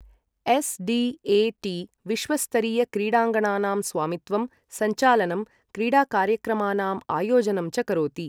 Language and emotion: Sanskrit, neutral